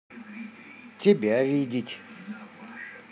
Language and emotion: Russian, positive